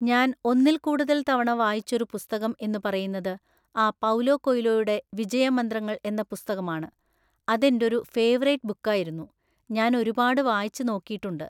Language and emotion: Malayalam, neutral